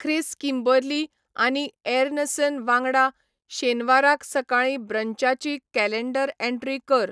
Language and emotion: Goan Konkani, neutral